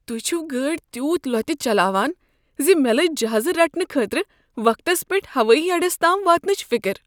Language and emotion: Kashmiri, fearful